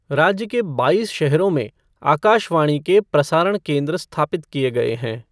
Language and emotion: Hindi, neutral